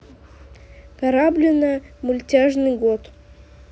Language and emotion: Russian, neutral